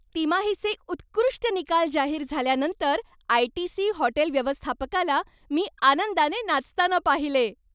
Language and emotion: Marathi, happy